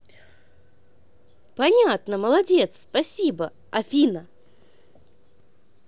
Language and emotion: Russian, positive